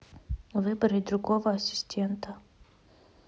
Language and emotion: Russian, neutral